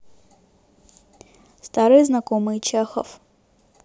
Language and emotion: Russian, neutral